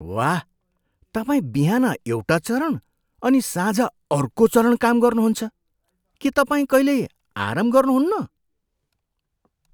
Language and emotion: Nepali, surprised